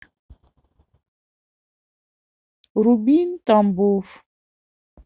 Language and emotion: Russian, neutral